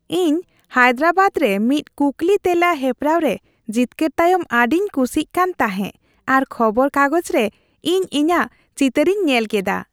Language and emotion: Santali, happy